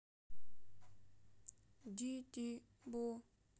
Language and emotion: Russian, sad